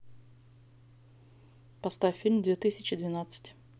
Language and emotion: Russian, neutral